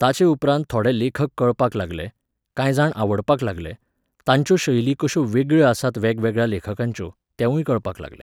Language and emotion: Goan Konkani, neutral